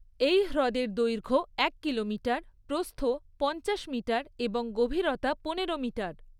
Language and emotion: Bengali, neutral